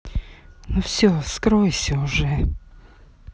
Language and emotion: Russian, angry